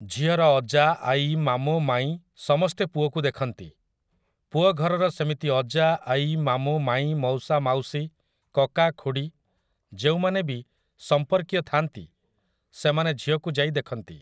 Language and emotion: Odia, neutral